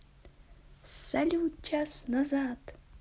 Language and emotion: Russian, positive